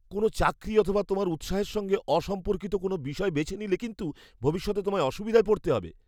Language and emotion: Bengali, fearful